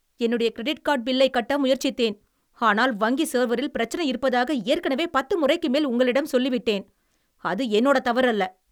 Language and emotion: Tamil, angry